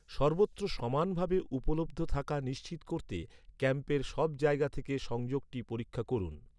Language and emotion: Bengali, neutral